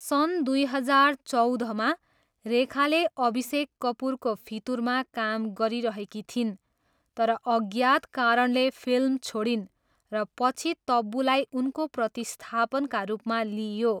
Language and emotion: Nepali, neutral